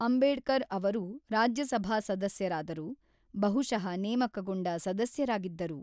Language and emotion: Kannada, neutral